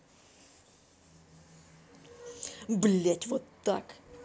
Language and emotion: Russian, angry